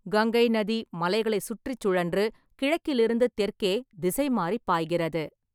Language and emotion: Tamil, neutral